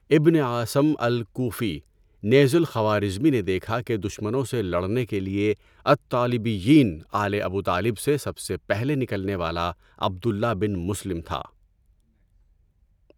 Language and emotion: Urdu, neutral